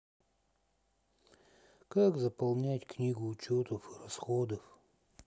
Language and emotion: Russian, sad